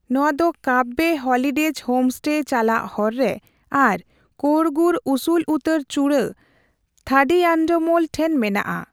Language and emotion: Santali, neutral